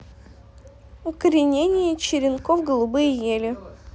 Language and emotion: Russian, neutral